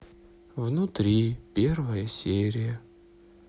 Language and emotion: Russian, sad